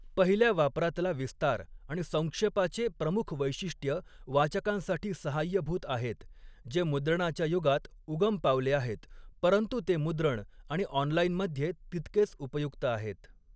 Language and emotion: Marathi, neutral